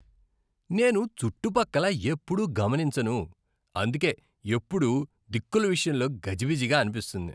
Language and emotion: Telugu, disgusted